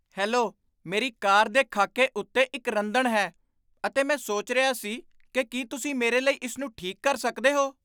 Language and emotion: Punjabi, surprised